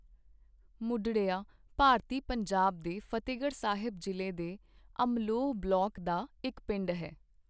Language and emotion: Punjabi, neutral